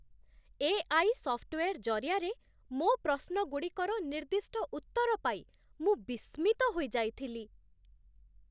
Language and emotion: Odia, surprised